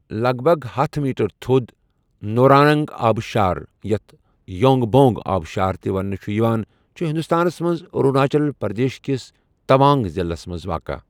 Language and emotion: Kashmiri, neutral